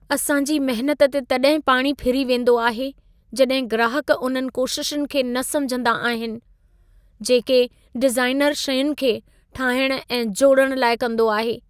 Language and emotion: Sindhi, sad